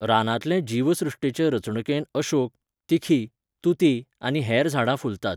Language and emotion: Goan Konkani, neutral